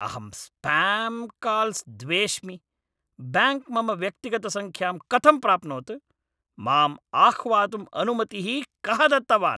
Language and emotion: Sanskrit, angry